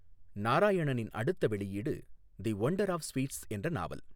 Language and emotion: Tamil, neutral